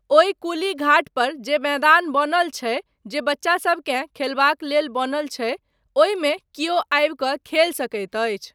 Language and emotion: Maithili, neutral